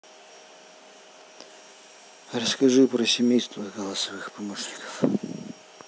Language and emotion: Russian, neutral